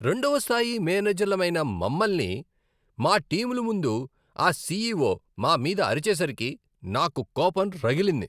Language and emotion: Telugu, angry